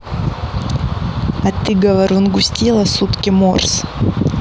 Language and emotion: Russian, neutral